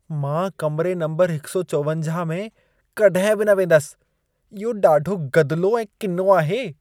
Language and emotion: Sindhi, disgusted